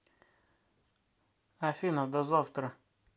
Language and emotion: Russian, neutral